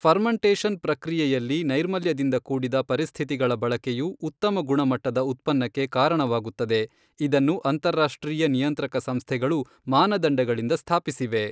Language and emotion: Kannada, neutral